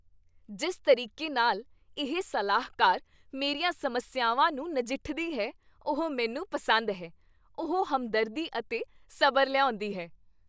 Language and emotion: Punjabi, happy